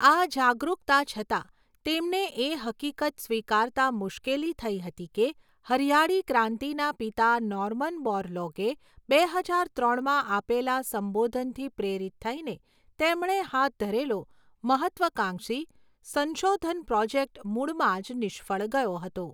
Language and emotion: Gujarati, neutral